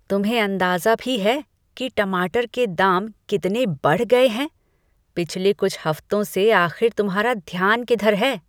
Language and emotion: Hindi, disgusted